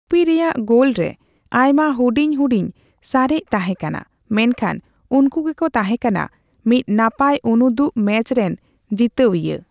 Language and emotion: Santali, neutral